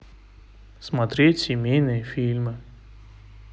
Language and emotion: Russian, neutral